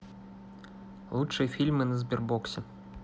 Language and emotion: Russian, neutral